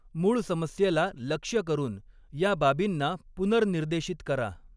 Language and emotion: Marathi, neutral